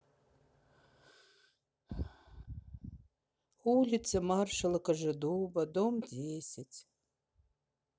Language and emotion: Russian, sad